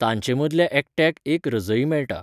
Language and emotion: Goan Konkani, neutral